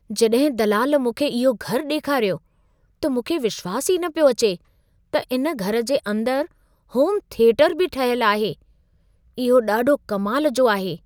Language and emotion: Sindhi, surprised